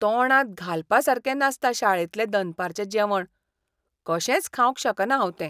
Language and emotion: Goan Konkani, disgusted